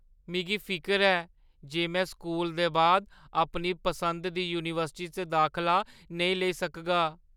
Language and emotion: Dogri, fearful